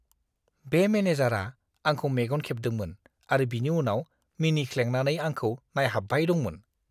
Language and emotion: Bodo, disgusted